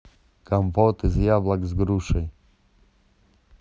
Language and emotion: Russian, neutral